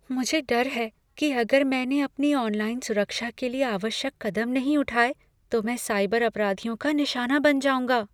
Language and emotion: Hindi, fearful